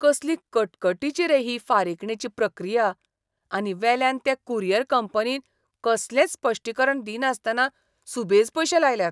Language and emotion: Goan Konkani, disgusted